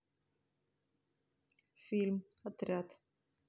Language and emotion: Russian, neutral